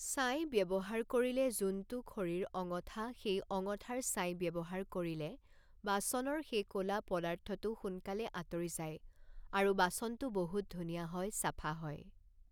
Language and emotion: Assamese, neutral